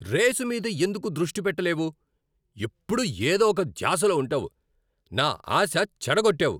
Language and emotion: Telugu, angry